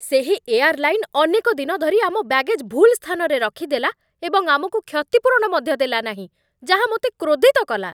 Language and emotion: Odia, angry